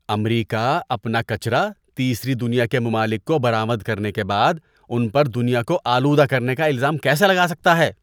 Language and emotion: Urdu, disgusted